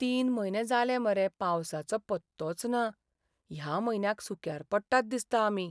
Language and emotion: Goan Konkani, sad